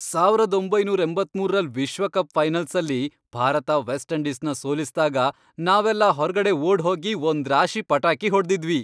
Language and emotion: Kannada, happy